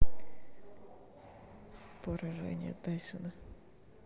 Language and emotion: Russian, neutral